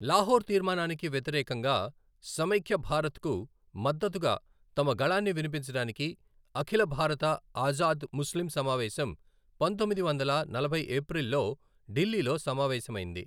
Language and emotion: Telugu, neutral